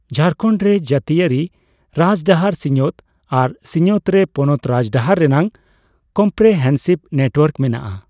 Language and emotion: Santali, neutral